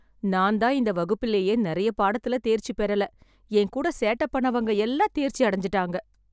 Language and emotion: Tamil, sad